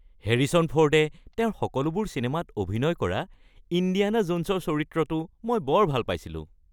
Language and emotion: Assamese, happy